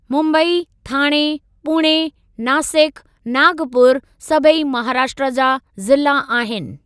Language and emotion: Sindhi, neutral